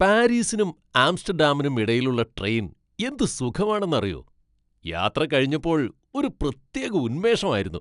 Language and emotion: Malayalam, happy